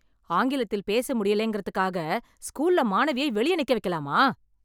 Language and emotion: Tamil, angry